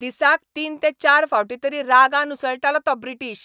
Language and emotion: Goan Konkani, angry